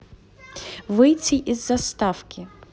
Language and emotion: Russian, neutral